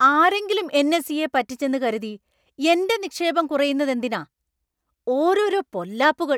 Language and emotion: Malayalam, angry